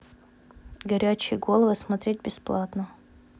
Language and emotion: Russian, neutral